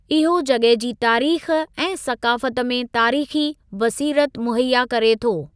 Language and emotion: Sindhi, neutral